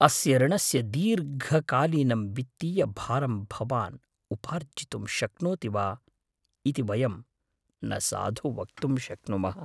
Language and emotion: Sanskrit, fearful